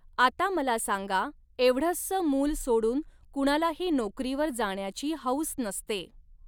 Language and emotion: Marathi, neutral